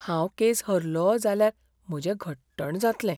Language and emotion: Goan Konkani, fearful